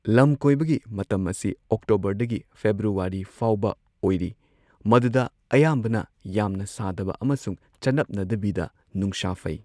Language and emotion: Manipuri, neutral